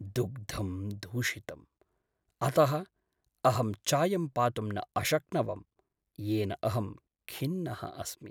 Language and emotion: Sanskrit, sad